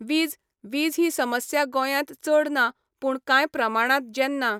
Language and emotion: Goan Konkani, neutral